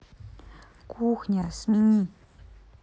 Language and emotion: Russian, neutral